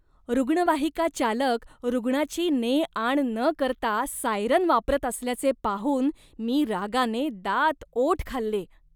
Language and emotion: Marathi, disgusted